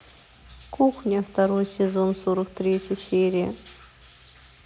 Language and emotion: Russian, neutral